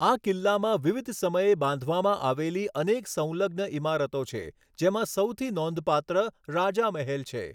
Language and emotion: Gujarati, neutral